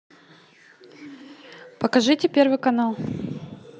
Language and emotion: Russian, neutral